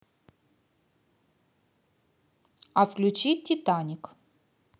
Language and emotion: Russian, positive